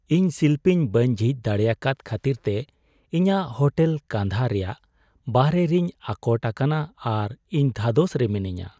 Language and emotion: Santali, sad